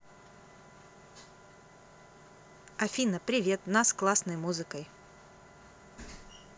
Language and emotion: Russian, positive